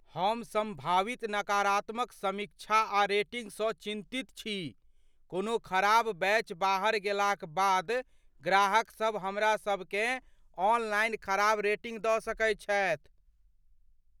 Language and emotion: Maithili, fearful